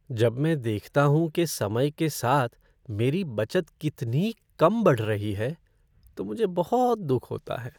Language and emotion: Hindi, sad